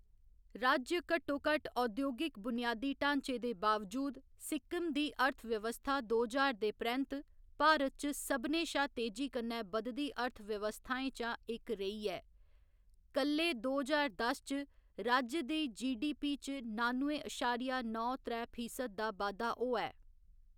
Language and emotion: Dogri, neutral